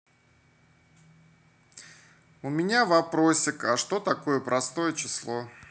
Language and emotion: Russian, neutral